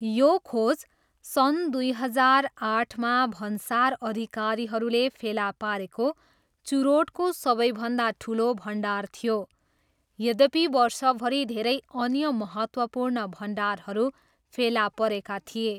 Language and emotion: Nepali, neutral